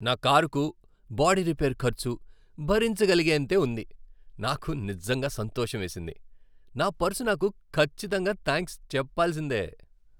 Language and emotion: Telugu, happy